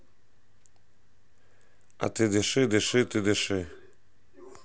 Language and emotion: Russian, neutral